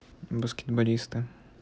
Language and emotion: Russian, neutral